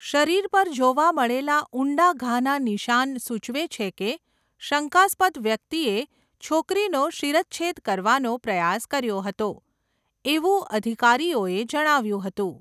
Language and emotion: Gujarati, neutral